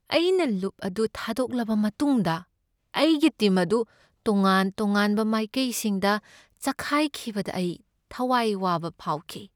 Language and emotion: Manipuri, sad